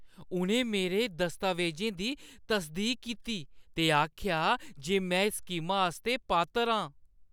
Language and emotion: Dogri, happy